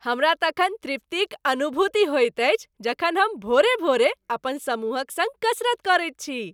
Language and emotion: Maithili, happy